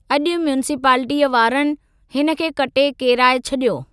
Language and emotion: Sindhi, neutral